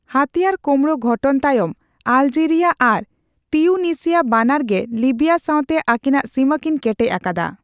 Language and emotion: Santali, neutral